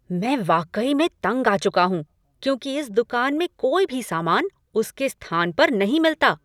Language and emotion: Hindi, angry